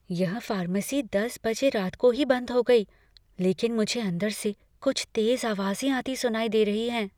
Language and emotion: Hindi, fearful